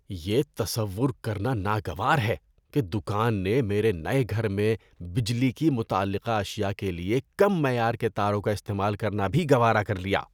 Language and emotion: Urdu, disgusted